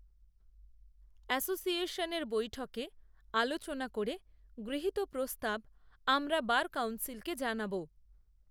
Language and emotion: Bengali, neutral